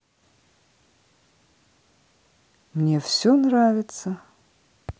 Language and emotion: Russian, neutral